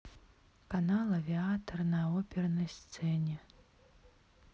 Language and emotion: Russian, sad